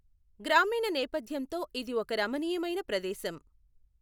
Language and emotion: Telugu, neutral